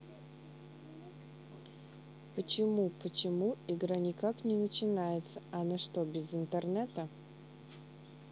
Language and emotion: Russian, neutral